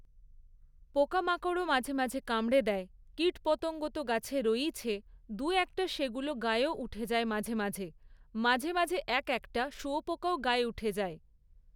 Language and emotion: Bengali, neutral